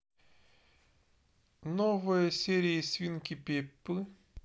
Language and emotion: Russian, neutral